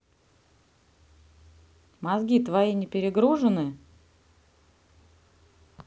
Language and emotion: Russian, neutral